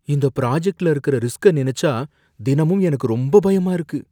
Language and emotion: Tamil, fearful